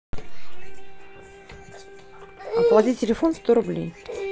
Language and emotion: Russian, neutral